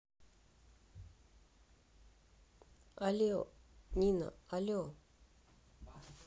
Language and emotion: Russian, neutral